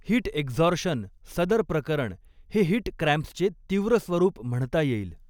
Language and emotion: Marathi, neutral